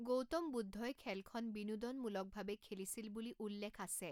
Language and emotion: Assamese, neutral